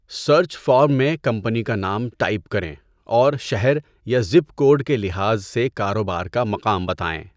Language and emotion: Urdu, neutral